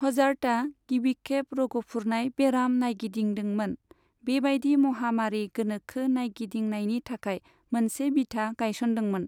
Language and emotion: Bodo, neutral